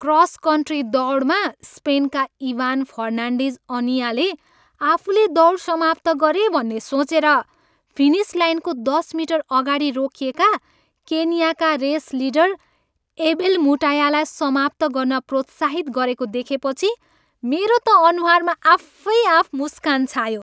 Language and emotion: Nepali, happy